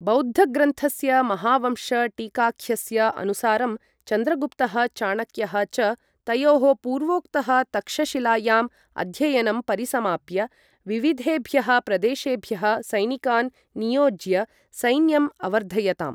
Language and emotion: Sanskrit, neutral